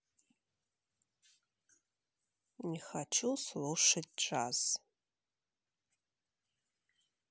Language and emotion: Russian, neutral